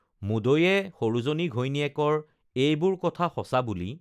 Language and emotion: Assamese, neutral